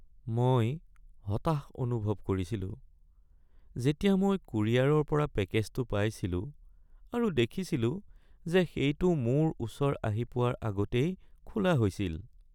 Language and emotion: Assamese, sad